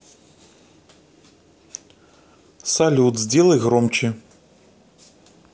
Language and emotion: Russian, neutral